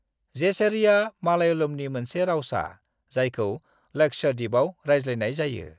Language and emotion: Bodo, neutral